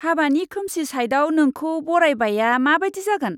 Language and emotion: Bodo, disgusted